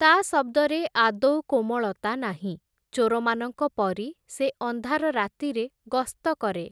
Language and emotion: Odia, neutral